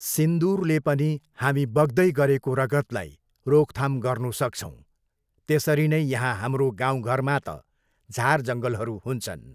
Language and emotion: Nepali, neutral